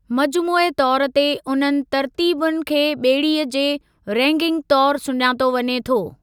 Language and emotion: Sindhi, neutral